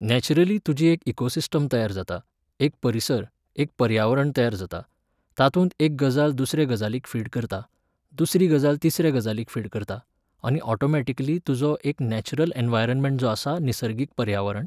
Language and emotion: Goan Konkani, neutral